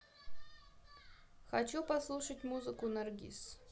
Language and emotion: Russian, neutral